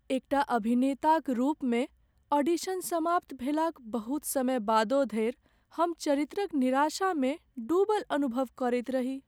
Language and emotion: Maithili, sad